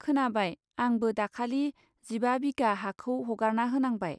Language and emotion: Bodo, neutral